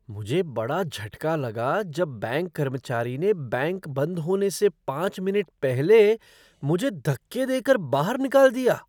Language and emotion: Hindi, surprised